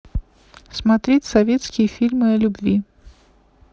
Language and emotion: Russian, neutral